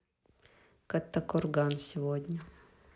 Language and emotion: Russian, neutral